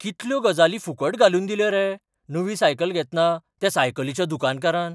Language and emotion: Goan Konkani, surprised